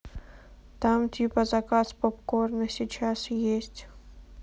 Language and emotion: Russian, sad